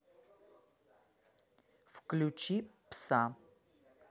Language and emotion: Russian, neutral